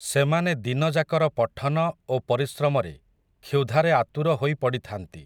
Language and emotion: Odia, neutral